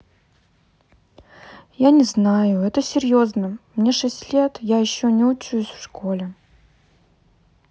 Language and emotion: Russian, sad